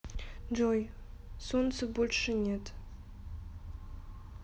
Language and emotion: Russian, sad